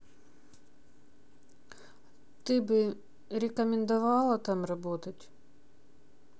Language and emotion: Russian, neutral